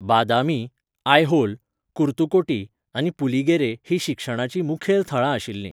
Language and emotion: Goan Konkani, neutral